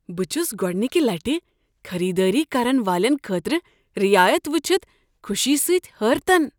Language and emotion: Kashmiri, surprised